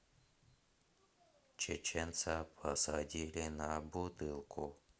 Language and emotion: Russian, neutral